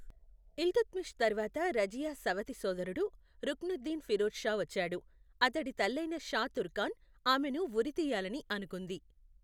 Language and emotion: Telugu, neutral